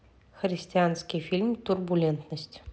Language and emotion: Russian, neutral